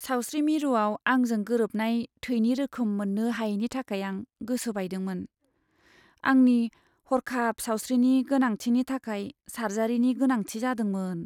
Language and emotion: Bodo, sad